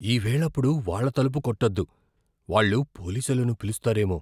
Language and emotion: Telugu, fearful